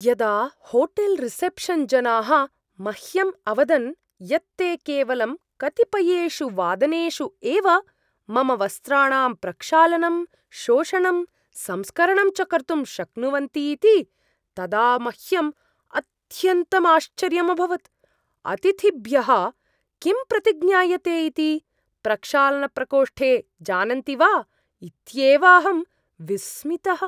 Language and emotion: Sanskrit, surprised